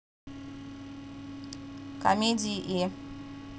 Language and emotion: Russian, neutral